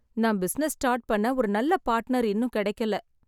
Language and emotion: Tamil, sad